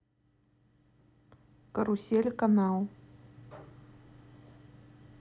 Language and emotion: Russian, neutral